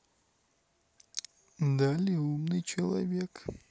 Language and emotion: Russian, neutral